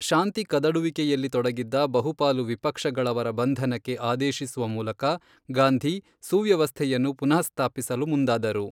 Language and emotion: Kannada, neutral